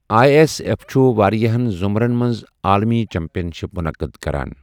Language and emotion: Kashmiri, neutral